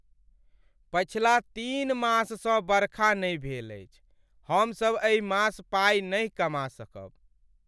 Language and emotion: Maithili, sad